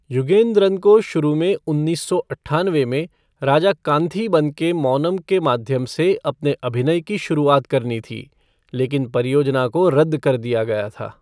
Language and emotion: Hindi, neutral